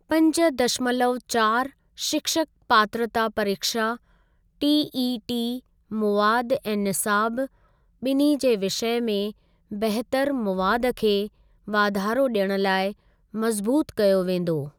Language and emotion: Sindhi, neutral